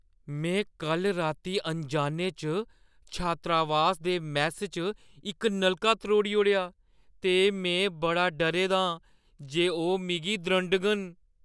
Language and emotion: Dogri, fearful